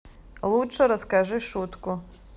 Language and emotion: Russian, neutral